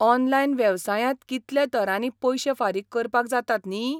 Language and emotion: Goan Konkani, surprised